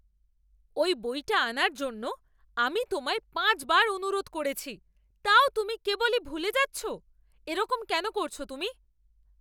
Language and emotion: Bengali, angry